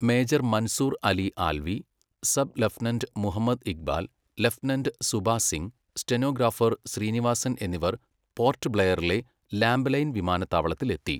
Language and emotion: Malayalam, neutral